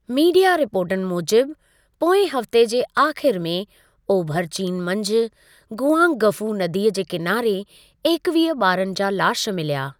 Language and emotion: Sindhi, neutral